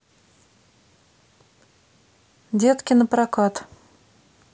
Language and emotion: Russian, neutral